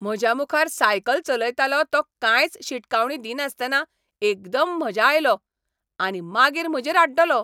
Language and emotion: Goan Konkani, angry